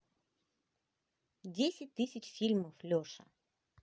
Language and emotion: Russian, positive